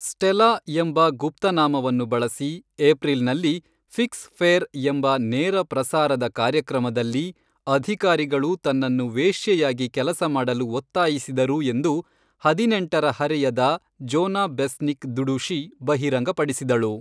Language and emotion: Kannada, neutral